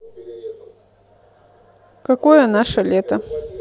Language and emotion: Russian, neutral